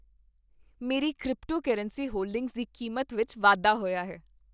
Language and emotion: Punjabi, happy